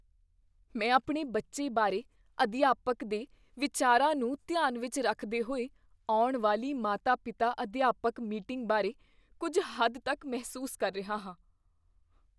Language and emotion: Punjabi, fearful